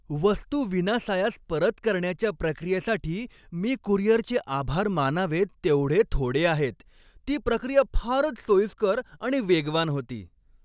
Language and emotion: Marathi, happy